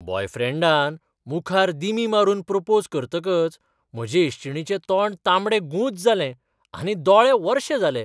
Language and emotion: Goan Konkani, surprised